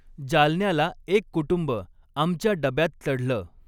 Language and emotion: Marathi, neutral